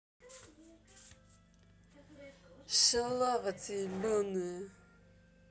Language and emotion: Russian, angry